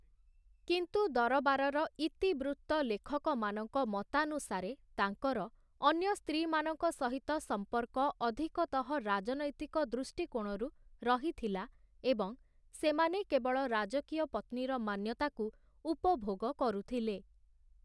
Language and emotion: Odia, neutral